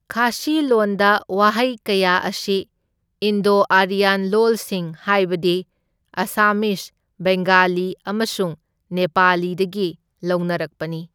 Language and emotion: Manipuri, neutral